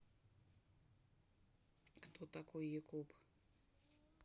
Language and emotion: Russian, neutral